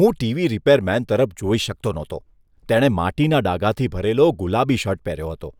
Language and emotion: Gujarati, disgusted